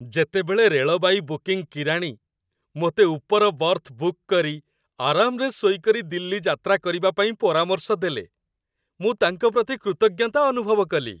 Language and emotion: Odia, happy